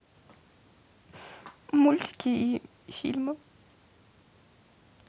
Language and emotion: Russian, sad